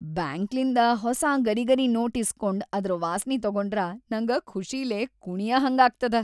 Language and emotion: Kannada, happy